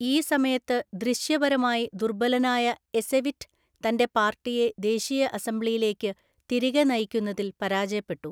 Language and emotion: Malayalam, neutral